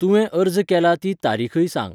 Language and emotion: Goan Konkani, neutral